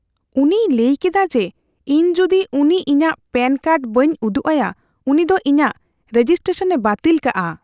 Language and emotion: Santali, fearful